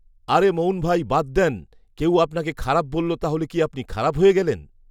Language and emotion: Bengali, neutral